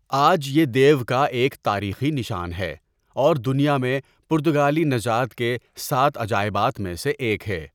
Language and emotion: Urdu, neutral